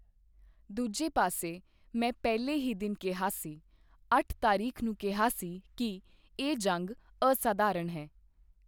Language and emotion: Punjabi, neutral